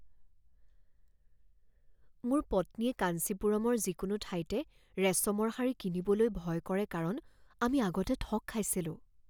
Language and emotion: Assamese, fearful